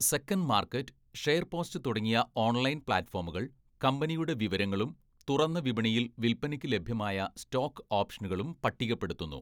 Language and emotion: Malayalam, neutral